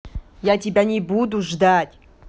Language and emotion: Russian, angry